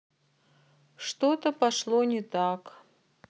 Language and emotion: Russian, sad